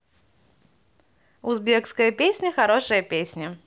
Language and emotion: Russian, positive